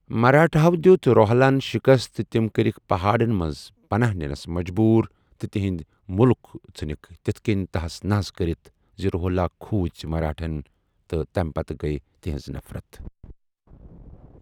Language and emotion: Kashmiri, neutral